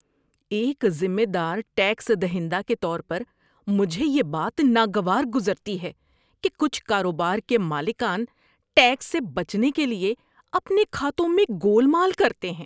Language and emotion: Urdu, disgusted